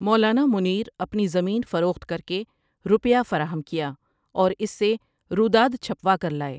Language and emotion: Urdu, neutral